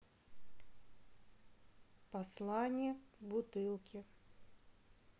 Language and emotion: Russian, neutral